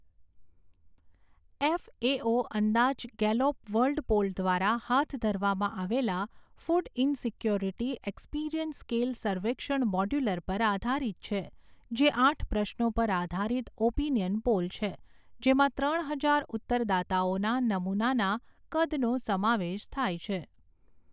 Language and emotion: Gujarati, neutral